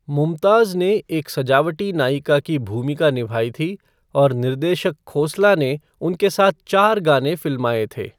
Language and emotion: Hindi, neutral